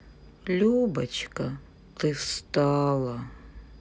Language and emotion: Russian, sad